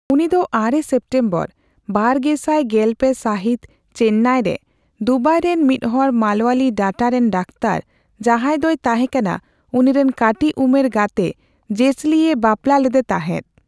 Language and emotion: Santali, neutral